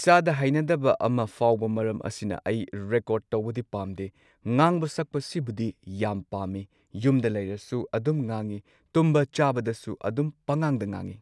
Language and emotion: Manipuri, neutral